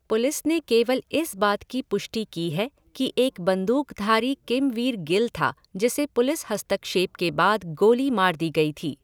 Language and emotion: Hindi, neutral